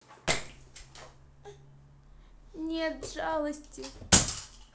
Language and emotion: Russian, sad